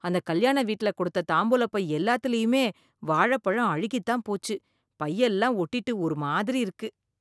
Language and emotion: Tamil, disgusted